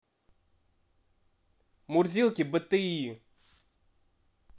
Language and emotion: Russian, neutral